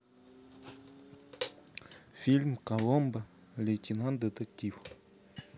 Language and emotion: Russian, neutral